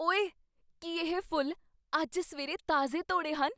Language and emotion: Punjabi, surprised